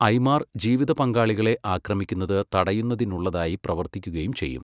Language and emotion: Malayalam, neutral